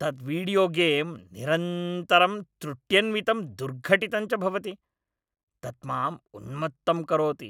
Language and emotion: Sanskrit, angry